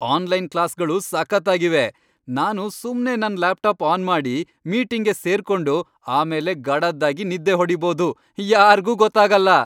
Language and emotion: Kannada, happy